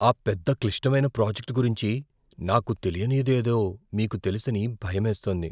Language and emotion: Telugu, fearful